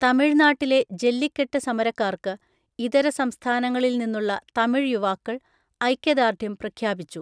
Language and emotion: Malayalam, neutral